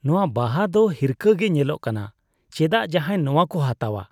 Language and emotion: Santali, disgusted